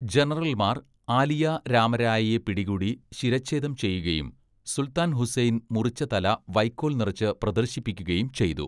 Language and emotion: Malayalam, neutral